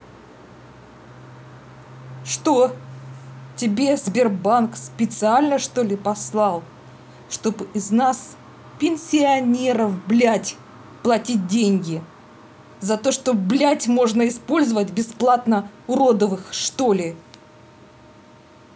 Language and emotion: Russian, angry